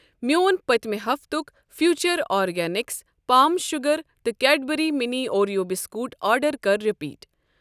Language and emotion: Kashmiri, neutral